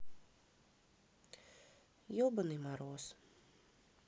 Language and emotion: Russian, sad